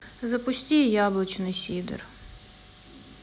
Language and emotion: Russian, sad